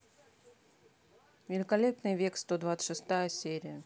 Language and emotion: Russian, neutral